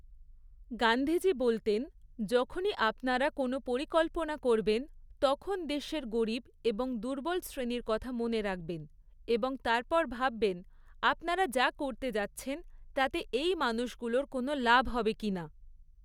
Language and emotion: Bengali, neutral